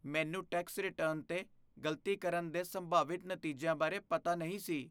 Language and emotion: Punjabi, fearful